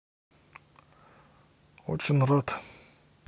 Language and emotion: Russian, neutral